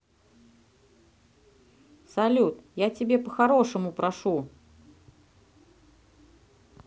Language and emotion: Russian, neutral